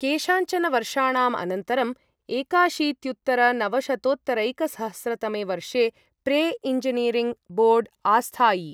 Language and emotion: Sanskrit, neutral